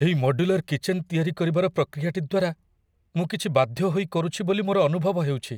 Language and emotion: Odia, fearful